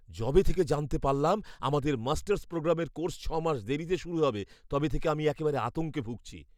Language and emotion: Bengali, fearful